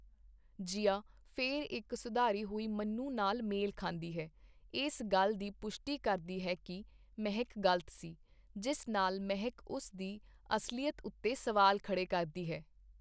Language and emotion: Punjabi, neutral